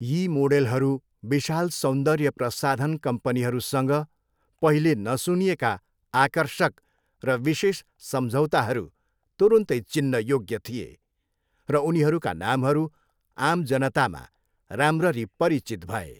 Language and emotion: Nepali, neutral